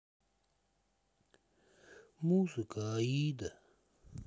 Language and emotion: Russian, sad